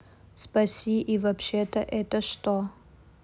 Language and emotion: Russian, neutral